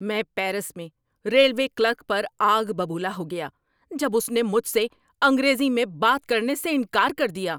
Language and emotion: Urdu, angry